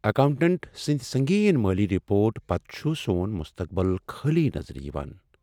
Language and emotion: Kashmiri, sad